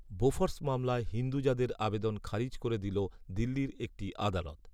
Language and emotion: Bengali, neutral